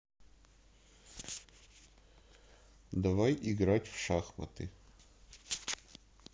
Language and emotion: Russian, neutral